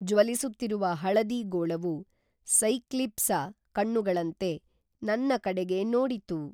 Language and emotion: Kannada, neutral